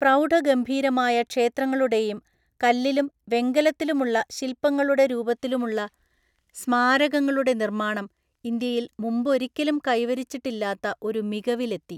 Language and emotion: Malayalam, neutral